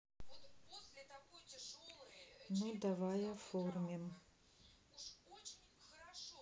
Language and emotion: Russian, sad